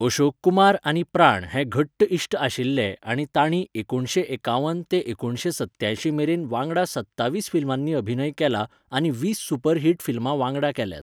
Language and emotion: Goan Konkani, neutral